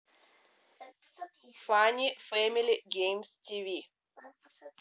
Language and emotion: Russian, neutral